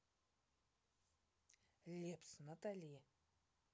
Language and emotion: Russian, neutral